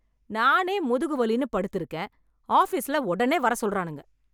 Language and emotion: Tamil, angry